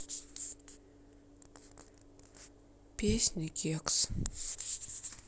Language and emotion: Russian, sad